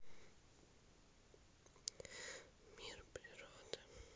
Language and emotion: Russian, sad